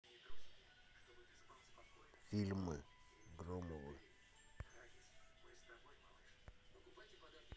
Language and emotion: Russian, neutral